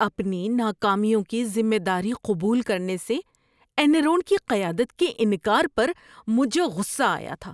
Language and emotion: Urdu, disgusted